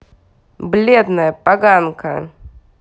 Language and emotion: Russian, angry